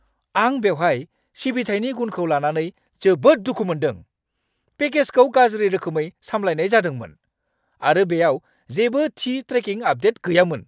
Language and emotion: Bodo, angry